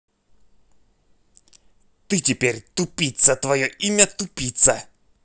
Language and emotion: Russian, angry